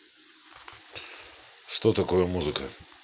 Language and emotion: Russian, neutral